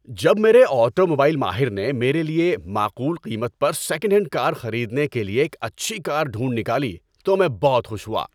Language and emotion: Urdu, happy